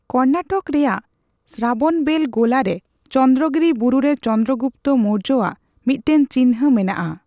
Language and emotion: Santali, neutral